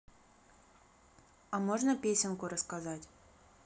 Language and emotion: Russian, neutral